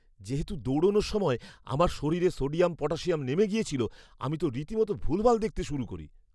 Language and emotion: Bengali, fearful